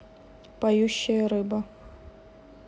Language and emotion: Russian, neutral